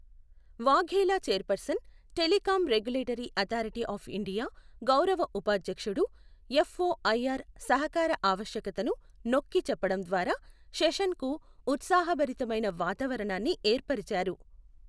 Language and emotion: Telugu, neutral